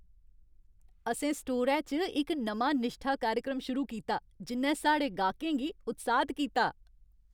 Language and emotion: Dogri, happy